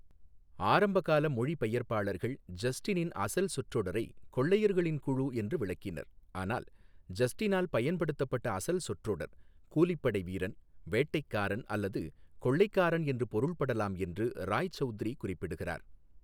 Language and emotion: Tamil, neutral